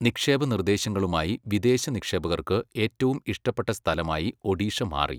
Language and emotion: Malayalam, neutral